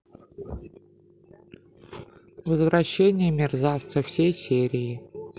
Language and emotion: Russian, neutral